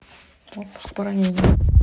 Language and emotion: Russian, neutral